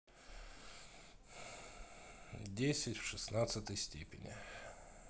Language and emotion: Russian, neutral